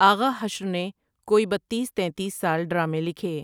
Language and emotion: Urdu, neutral